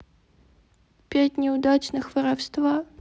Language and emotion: Russian, sad